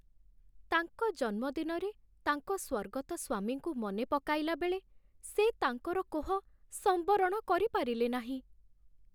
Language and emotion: Odia, sad